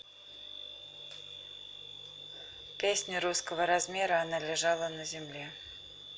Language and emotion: Russian, neutral